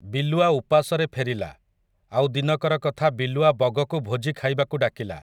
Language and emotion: Odia, neutral